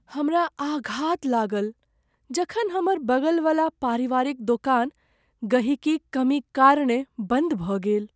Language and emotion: Maithili, sad